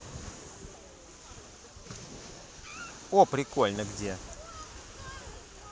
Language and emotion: Russian, positive